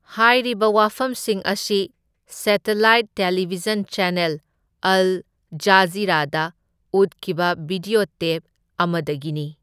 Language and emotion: Manipuri, neutral